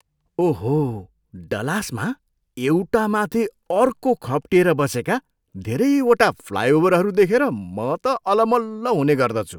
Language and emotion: Nepali, surprised